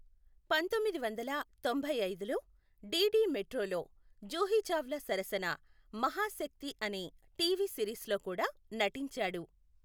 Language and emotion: Telugu, neutral